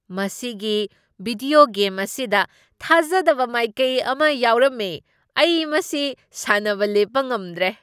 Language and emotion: Manipuri, surprised